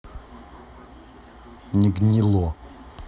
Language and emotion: Russian, neutral